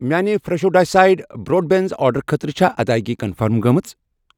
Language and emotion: Kashmiri, neutral